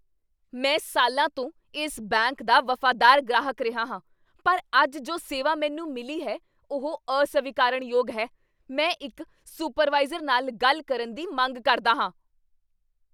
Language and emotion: Punjabi, angry